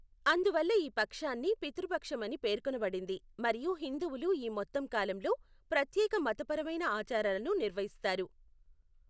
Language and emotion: Telugu, neutral